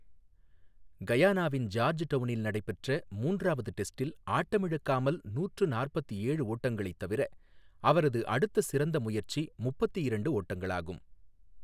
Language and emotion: Tamil, neutral